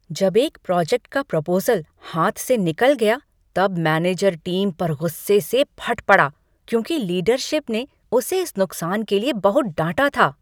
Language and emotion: Hindi, angry